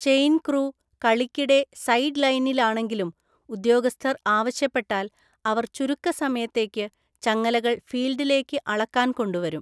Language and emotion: Malayalam, neutral